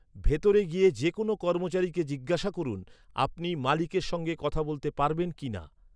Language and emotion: Bengali, neutral